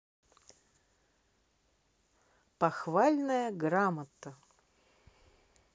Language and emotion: Russian, positive